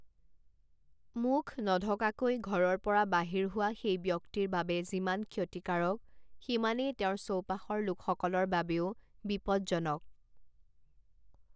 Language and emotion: Assamese, neutral